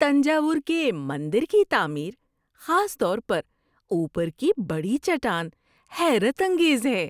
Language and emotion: Urdu, surprised